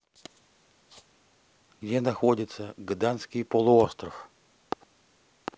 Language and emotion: Russian, neutral